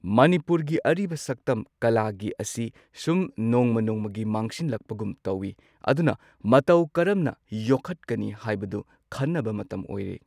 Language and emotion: Manipuri, neutral